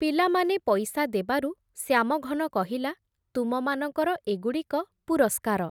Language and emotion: Odia, neutral